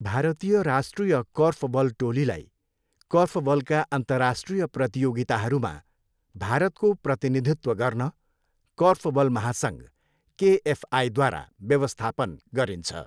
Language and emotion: Nepali, neutral